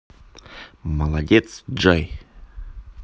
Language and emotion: Russian, positive